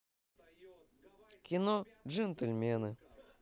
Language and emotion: Russian, positive